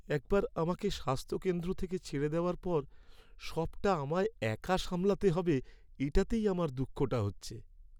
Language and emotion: Bengali, sad